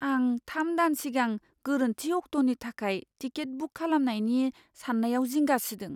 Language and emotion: Bodo, fearful